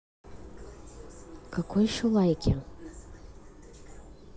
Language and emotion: Russian, neutral